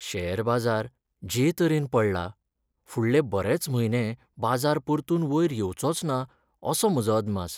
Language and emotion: Goan Konkani, sad